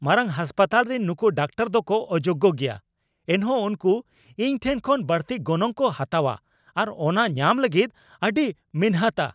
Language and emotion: Santali, angry